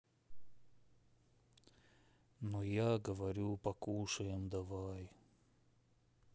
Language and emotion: Russian, sad